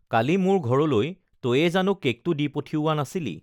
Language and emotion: Assamese, neutral